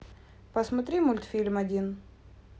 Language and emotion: Russian, neutral